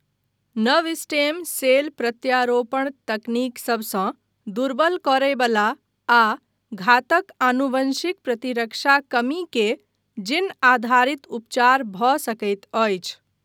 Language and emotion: Maithili, neutral